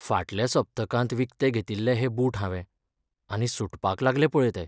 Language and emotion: Goan Konkani, sad